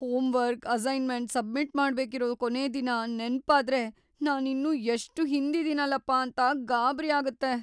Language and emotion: Kannada, fearful